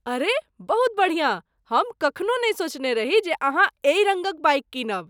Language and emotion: Maithili, surprised